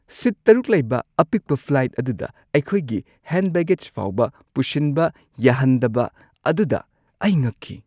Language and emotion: Manipuri, surprised